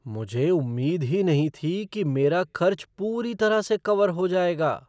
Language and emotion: Hindi, surprised